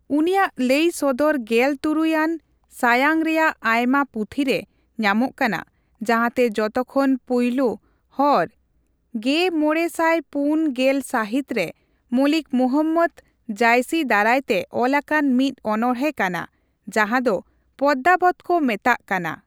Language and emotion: Santali, neutral